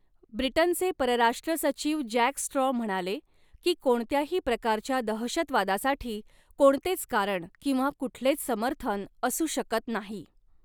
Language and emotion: Marathi, neutral